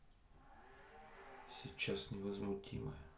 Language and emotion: Russian, neutral